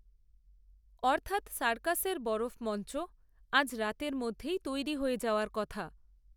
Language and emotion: Bengali, neutral